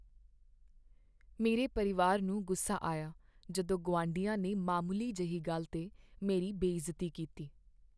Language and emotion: Punjabi, sad